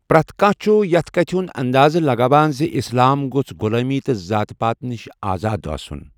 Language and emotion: Kashmiri, neutral